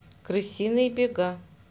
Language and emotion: Russian, neutral